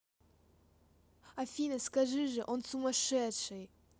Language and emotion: Russian, neutral